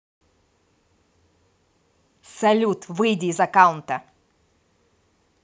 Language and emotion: Russian, angry